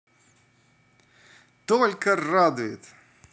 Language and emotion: Russian, positive